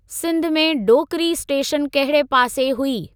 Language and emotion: Sindhi, neutral